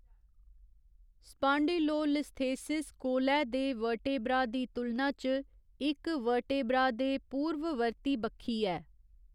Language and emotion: Dogri, neutral